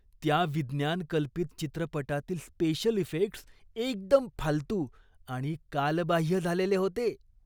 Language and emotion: Marathi, disgusted